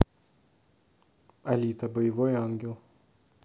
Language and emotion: Russian, neutral